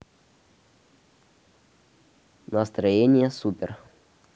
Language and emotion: Russian, neutral